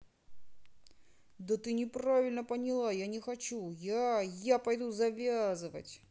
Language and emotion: Russian, angry